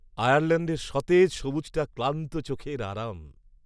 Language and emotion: Bengali, happy